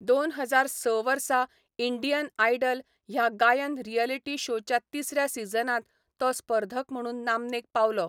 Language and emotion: Goan Konkani, neutral